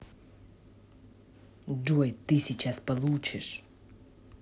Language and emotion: Russian, angry